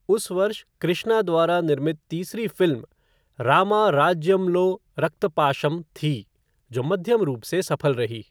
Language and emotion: Hindi, neutral